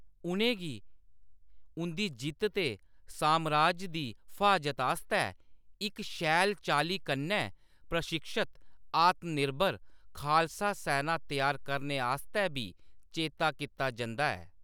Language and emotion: Dogri, neutral